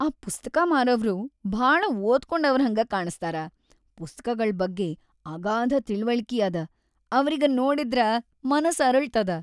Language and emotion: Kannada, happy